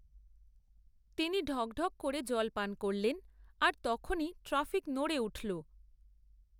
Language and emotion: Bengali, neutral